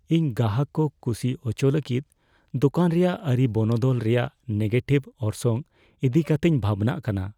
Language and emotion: Santali, fearful